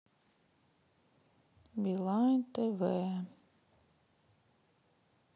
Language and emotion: Russian, sad